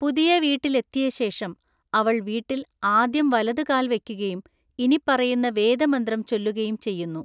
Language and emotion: Malayalam, neutral